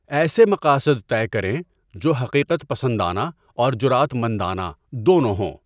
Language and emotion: Urdu, neutral